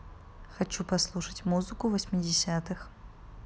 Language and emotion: Russian, neutral